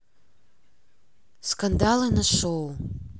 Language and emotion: Russian, neutral